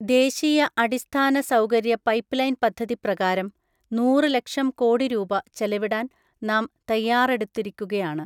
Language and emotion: Malayalam, neutral